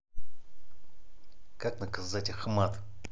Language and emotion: Russian, angry